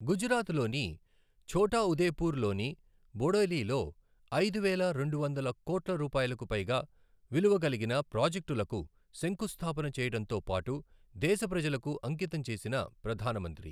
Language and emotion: Telugu, neutral